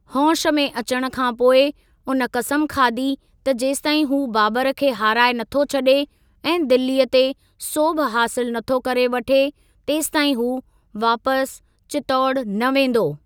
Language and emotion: Sindhi, neutral